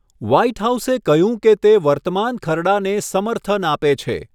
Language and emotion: Gujarati, neutral